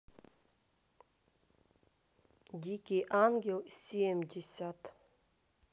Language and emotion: Russian, neutral